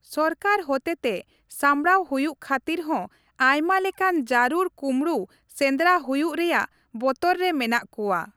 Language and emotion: Santali, neutral